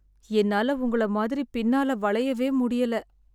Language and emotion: Tamil, sad